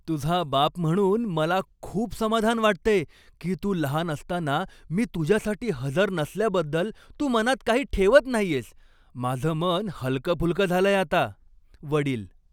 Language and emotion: Marathi, happy